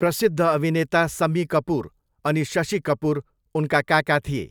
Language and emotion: Nepali, neutral